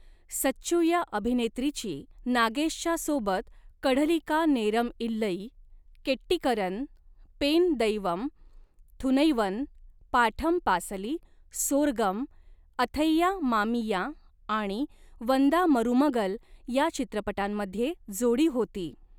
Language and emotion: Marathi, neutral